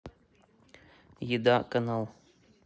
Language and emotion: Russian, neutral